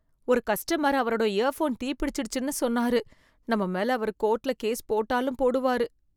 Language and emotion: Tamil, fearful